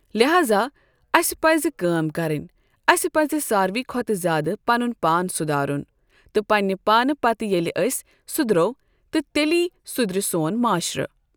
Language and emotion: Kashmiri, neutral